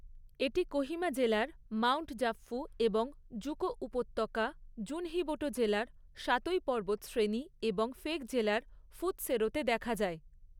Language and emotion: Bengali, neutral